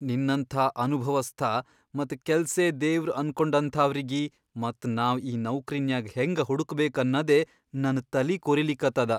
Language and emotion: Kannada, fearful